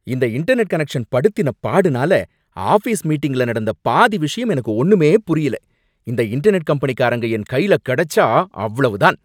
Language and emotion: Tamil, angry